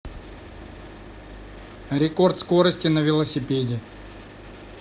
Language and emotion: Russian, neutral